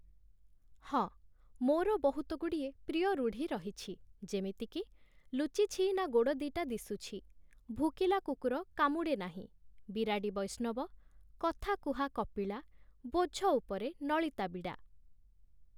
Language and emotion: Odia, neutral